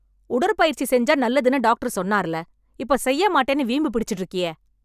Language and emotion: Tamil, angry